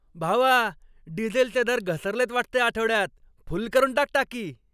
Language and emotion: Marathi, happy